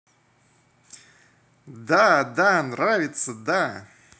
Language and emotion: Russian, positive